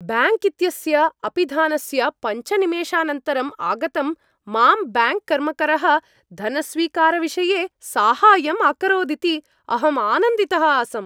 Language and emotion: Sanskrit, happy